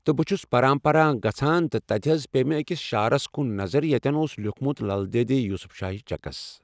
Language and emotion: Kashmiri, neutral